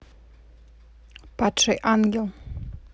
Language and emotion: Russian, neutral